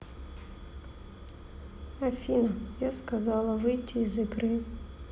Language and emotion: Russian, sad